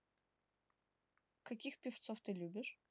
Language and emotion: Russian, neutral